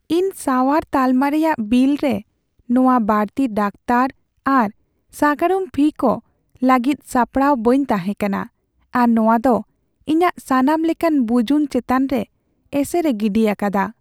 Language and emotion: Santali, sad